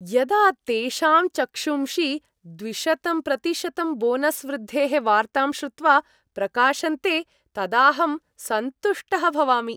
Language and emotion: Sanskrit, happy